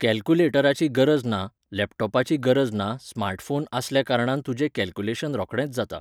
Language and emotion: Goan Konkani, neutral